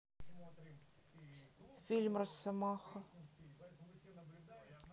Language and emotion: Russian, neutral